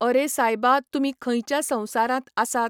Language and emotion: Goan Konkani, neutral